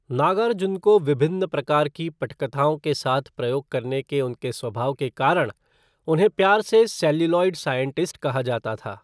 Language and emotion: Hindi, neutral